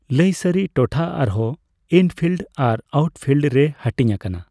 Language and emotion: Santali, neutral